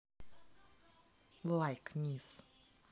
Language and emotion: Russian, neutral